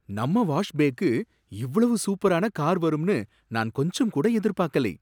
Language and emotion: Tamil, surprised